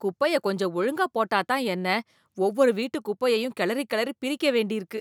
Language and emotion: Tamil, disgusted